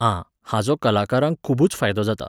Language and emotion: Goan Konkani, neutral